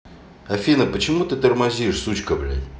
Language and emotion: Russian, angry